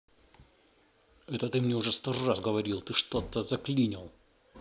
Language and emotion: Russian, angry